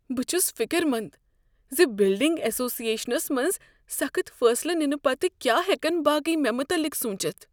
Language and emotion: Kashmiri, fearful